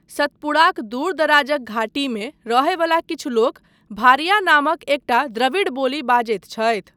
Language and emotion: Maithili, neutral